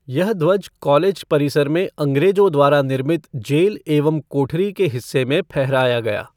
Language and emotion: Hindi, neutral